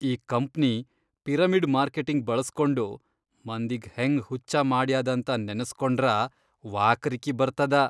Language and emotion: Kannada, disgusted